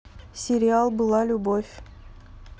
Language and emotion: Russian, neutral